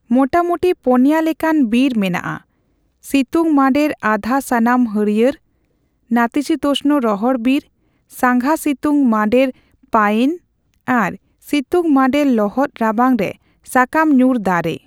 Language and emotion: Santali, neutral